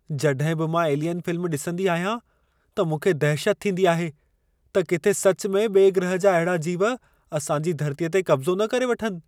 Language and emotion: Sindhi, fearful